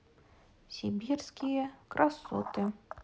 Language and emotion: Russian, neutral